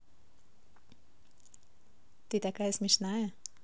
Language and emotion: Russian, positive